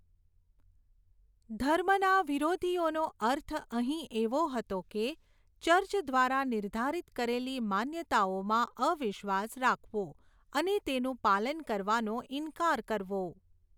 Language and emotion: Gujarati, neutral